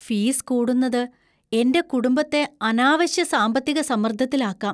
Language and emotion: Malayalam, fearful